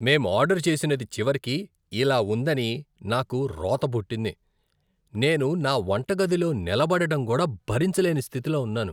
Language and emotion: Telugu, disgusted